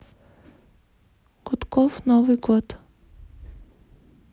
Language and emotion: Russian, neutral